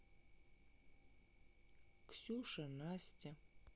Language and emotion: Russian, neutral